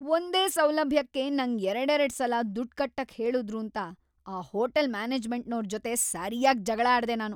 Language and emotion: Kannada, angry